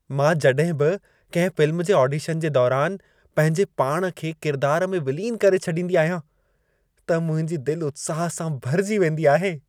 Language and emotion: Sindhi, happy